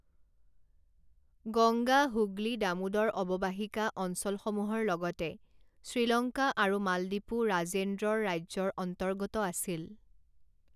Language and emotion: Assamese, neutral